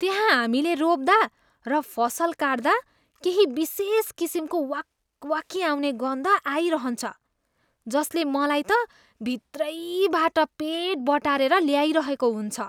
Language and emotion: Nepali, disgusted